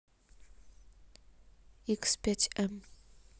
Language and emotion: Russian, neutral